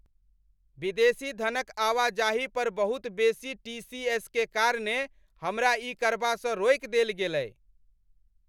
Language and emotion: Maithili, angry